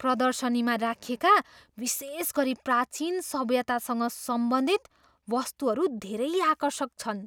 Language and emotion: Nepali, surprised